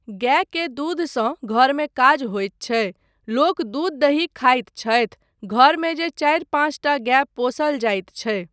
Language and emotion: Maithili, neutral